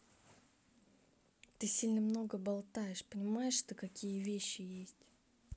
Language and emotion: Russian, angry